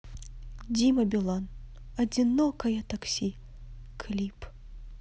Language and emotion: Russian, neutral